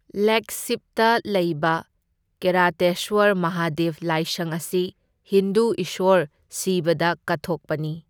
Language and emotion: Manipuri, neutral